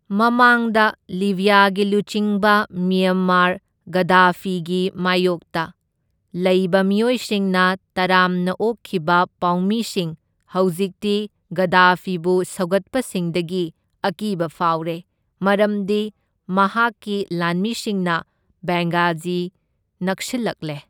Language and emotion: Manipuri, neutral